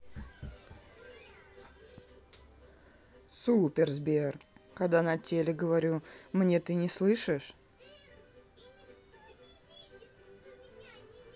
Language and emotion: Russian, angry